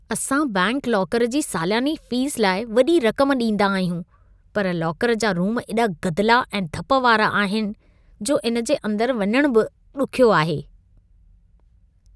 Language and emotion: Sindhi, disgusted